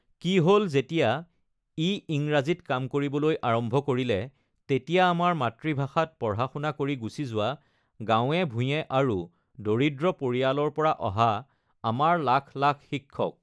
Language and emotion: Assamese, neutral